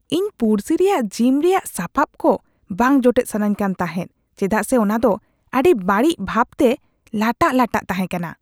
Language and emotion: Santali, disgusted